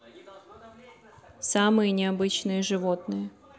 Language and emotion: Russian, neutral